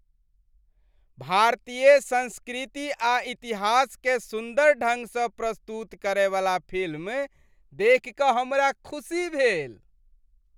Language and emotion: Maithili, happy